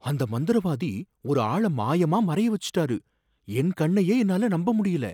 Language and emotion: Tamil, surprised